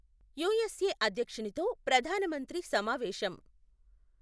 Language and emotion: Telugu, neutral